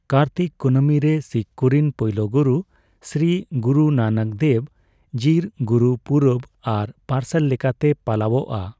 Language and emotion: Santali, neutral